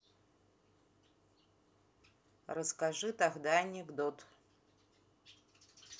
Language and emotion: Russian, neutral